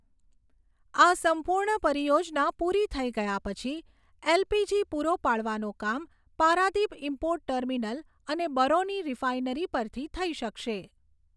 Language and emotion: Gujarati, neutral